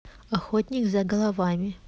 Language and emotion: Russian, neutral